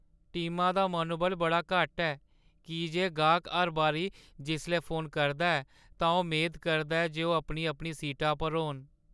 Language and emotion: Dogri, sad